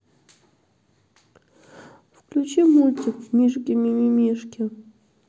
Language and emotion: Russian, sad